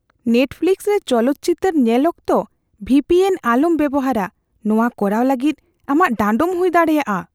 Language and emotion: Santali, fearful